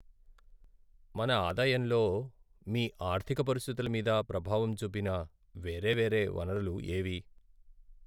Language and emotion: Telugu, sad